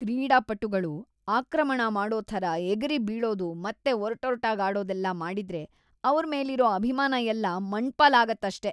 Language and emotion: Kannada, disgusted